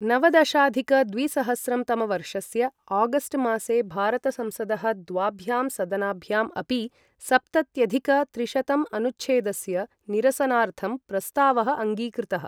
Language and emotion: Sanskrit, neutral